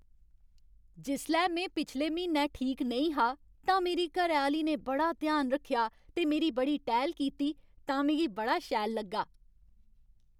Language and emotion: Dogri, happy